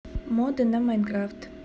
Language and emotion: Russian, neutral